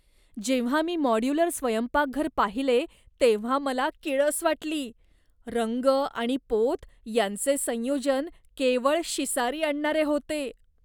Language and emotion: Marathi, disgusted